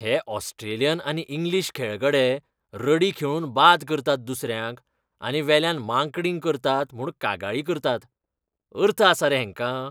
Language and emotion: Goan Konkani, disgusted